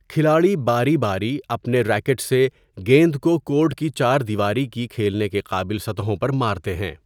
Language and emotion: Urdu, neutral